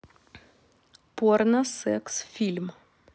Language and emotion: Russian, neutral